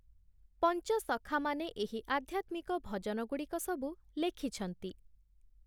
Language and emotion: Odia, neutral